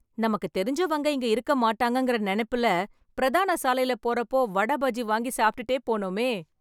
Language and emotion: Tamil, happy